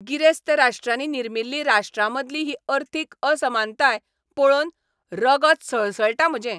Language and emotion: Goan Konkani, angry